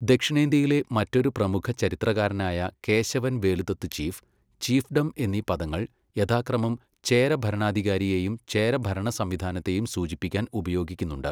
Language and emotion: Malayalam, neutral